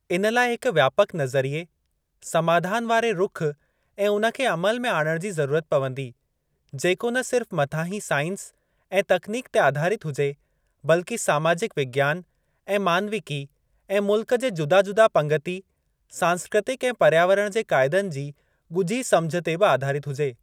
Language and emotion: Sindhi, neutral